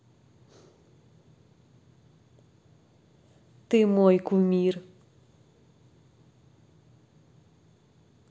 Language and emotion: Russian, positive